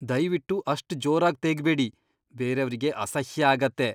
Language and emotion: Kannada, disgusted